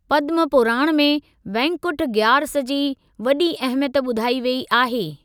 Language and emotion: Sindhi, neutral